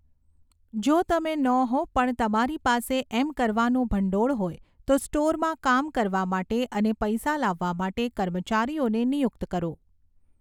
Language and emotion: Gujarati, neutral